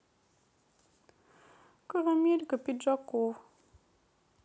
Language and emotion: Russian, sad